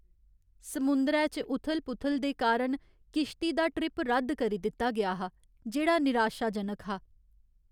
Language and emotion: Dogri, sad